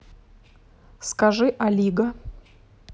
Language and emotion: Russian, neutral